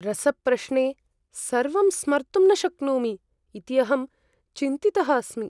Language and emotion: Sanskrit, fearful